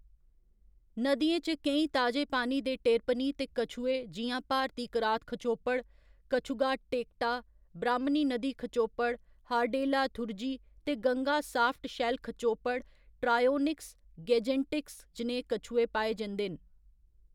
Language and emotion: Dogri, neutral